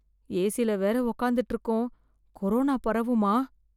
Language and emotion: Tamil, fearful